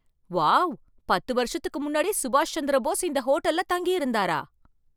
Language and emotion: Tamil, surprised